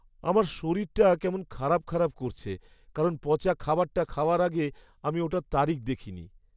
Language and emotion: Bengali, sad